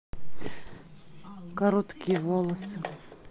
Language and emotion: Russian, neutral